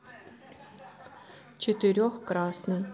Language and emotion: Russian, neutral